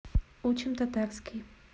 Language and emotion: Russian, neutral